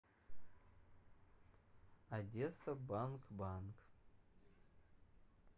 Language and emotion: Russian, neutral